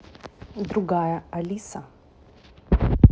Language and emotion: Russian, neutral